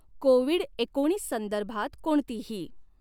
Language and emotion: Marathi, neutral